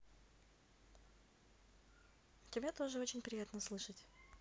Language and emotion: Russian, positive